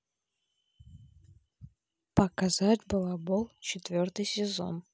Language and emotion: Russian, neutral